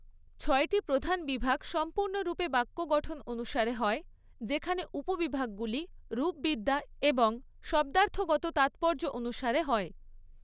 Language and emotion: Bengali, neutral